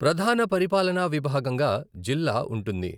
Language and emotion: Telugu, neutral